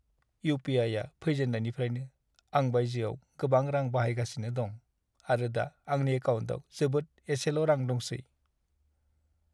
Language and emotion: Bodo, sad